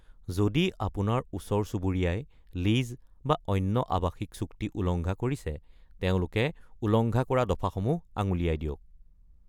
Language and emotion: Assamese, neutral